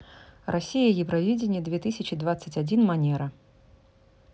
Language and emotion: Russian, neutral